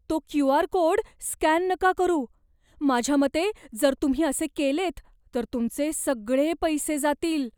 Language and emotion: Marathi, fearful